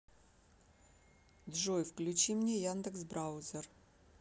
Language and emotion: Russian, neutral